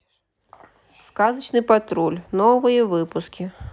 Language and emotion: Russian, neutral